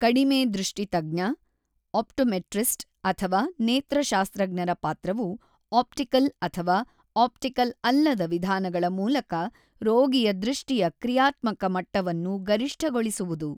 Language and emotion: Kannada, neutral